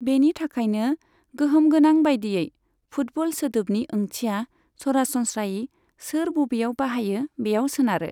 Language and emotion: Bodo, neutral